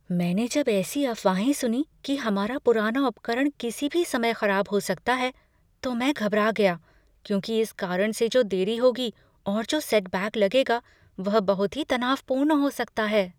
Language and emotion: Hindi, fearful